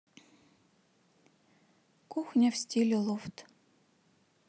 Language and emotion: Russian, neutral